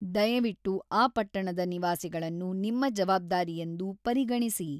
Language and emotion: Kannada, neutral